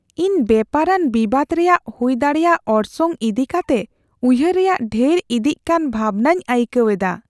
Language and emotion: Santali, fearful